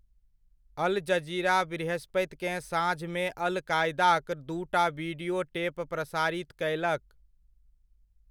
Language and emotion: Maithili, neutral